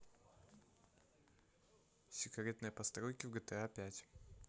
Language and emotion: Russian, neutral